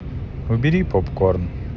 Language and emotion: Russian, neutral